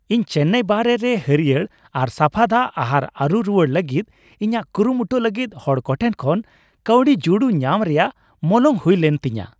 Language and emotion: Santali, happy